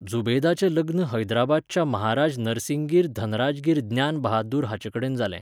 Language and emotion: Goan Konkani, neutral